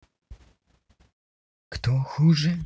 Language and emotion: Russian, angry